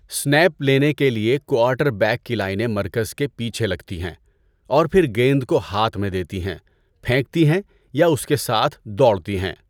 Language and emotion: Urdu, neutral